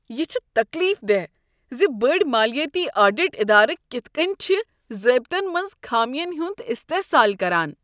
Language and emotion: Kashmiri, disgusted